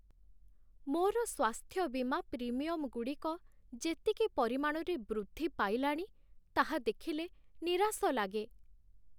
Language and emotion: Odia, sad